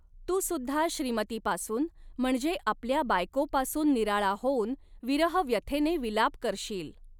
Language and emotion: Marathi, neutral